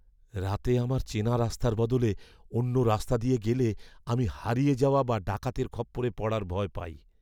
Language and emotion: Bengali, fearful